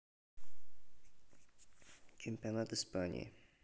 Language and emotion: Russian, neutral